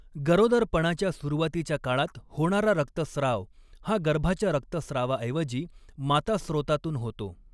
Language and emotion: Marathi, neutral